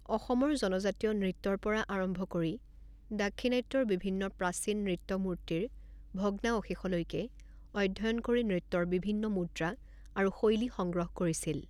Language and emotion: Assamese, neutral